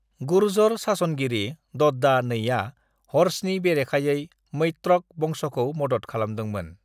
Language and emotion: Bodo, neutral